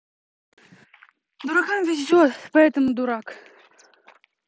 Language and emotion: Russian, neutral